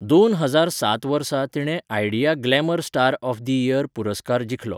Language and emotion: Goan Konkani, neutral